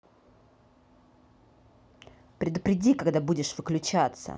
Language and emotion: Russian, angry